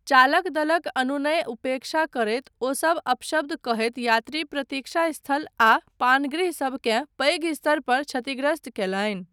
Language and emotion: Maithili, neutral